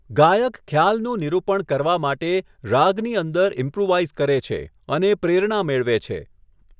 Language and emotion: Gujarati, neutral